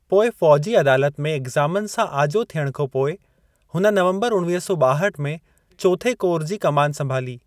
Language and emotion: Sindhi, neutral